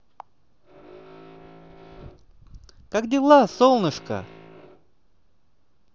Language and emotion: Russian, positive